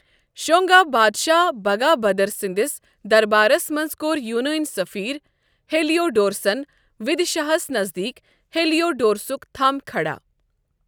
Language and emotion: Kashmiri, neutral